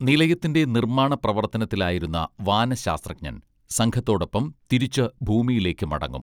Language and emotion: Malayalam, neutral